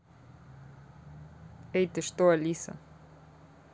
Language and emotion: Russian, neutral